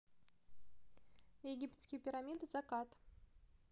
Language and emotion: Russian, neutral